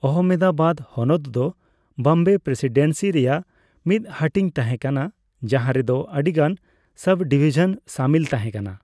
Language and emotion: Santali, neutral